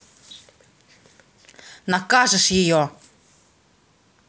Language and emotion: Russian, angry